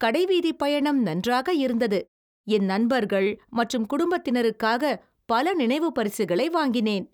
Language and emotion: Tamil, happy